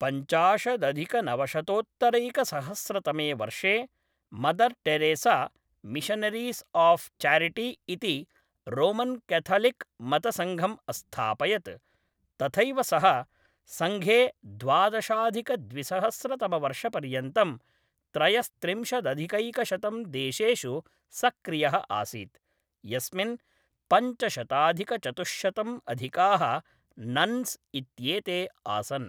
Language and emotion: Sanskrit, neutral